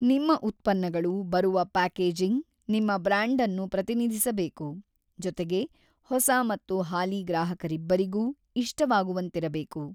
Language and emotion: Kannada, neutral